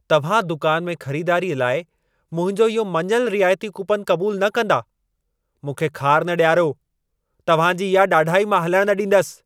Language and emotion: Sindhi, angry